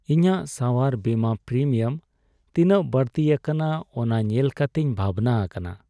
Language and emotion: Santali, sad